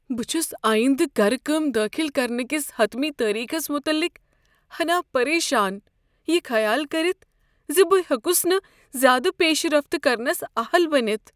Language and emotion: Kashmiri, fearful